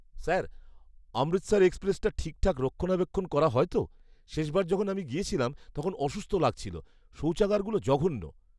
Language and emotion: Bengali, disgusted